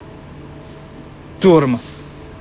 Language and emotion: Russian, angry